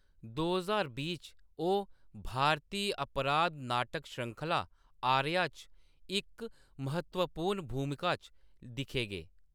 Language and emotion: Dogri, neutral